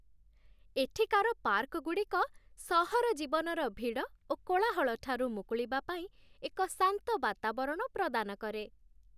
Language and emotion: Odia, happy